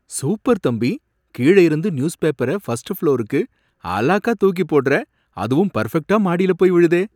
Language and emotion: Tamil, surprised